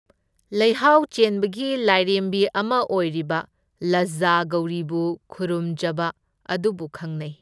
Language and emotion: Manipuri, neutral